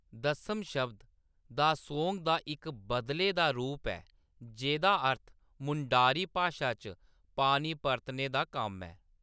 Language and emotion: Dogri, neutral